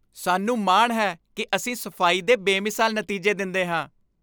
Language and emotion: Punjabi, happy